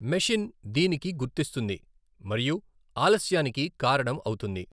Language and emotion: Telugu, neutral